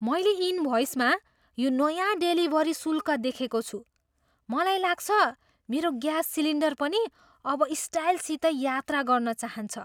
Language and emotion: Nepali, surprised